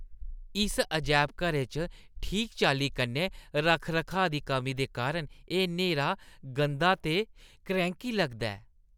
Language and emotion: Dogri, disgusted